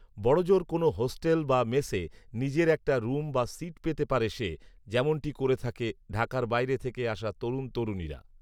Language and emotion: Bengali, neutral